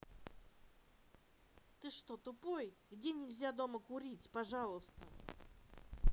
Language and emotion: Russian, angry